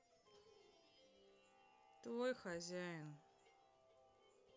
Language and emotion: Russian, sad